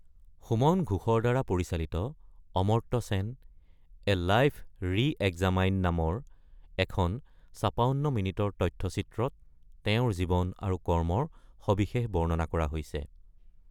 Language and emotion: Assamese, neutral